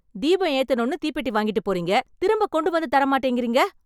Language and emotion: Tamil, angry